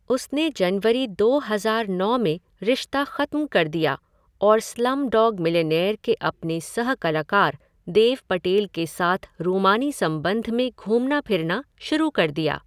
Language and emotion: Hindi, neutral